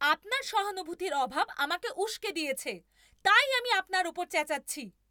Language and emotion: Bengali, angry